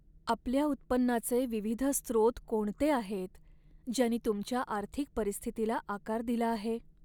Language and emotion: Marathi, sad